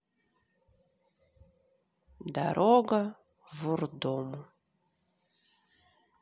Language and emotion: Russian, neutral